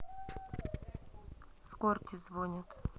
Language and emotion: Russian, neutral